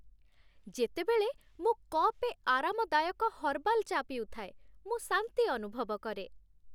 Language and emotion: Odia, happy